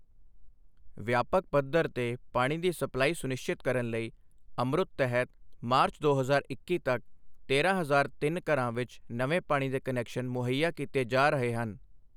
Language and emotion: Punjabi, neutral